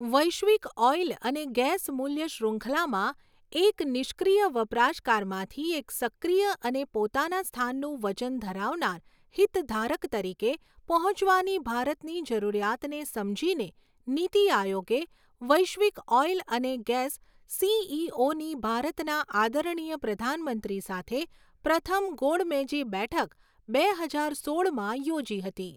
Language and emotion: Gujarati, neutral